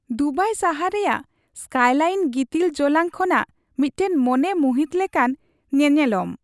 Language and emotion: Santali, happy